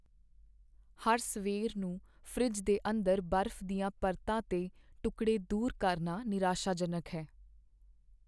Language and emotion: Punjabi, sad